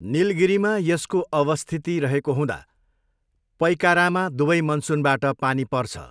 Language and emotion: Nepali, neutral